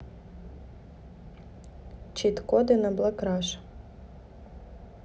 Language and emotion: Russian, neutral